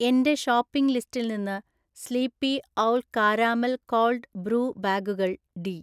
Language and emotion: Malayalam, neutral